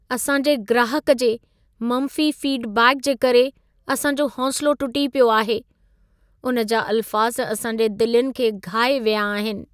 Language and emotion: Sindhi, sad